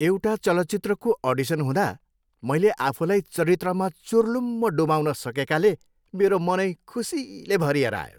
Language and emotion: Nepali, happy